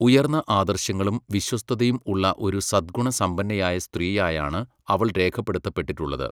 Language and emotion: Malayalam, neutral